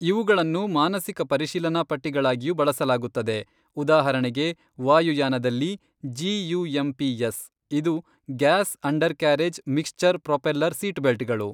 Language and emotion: Kannada, neutral